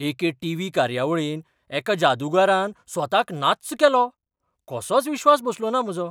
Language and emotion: Goan Konkani, surprised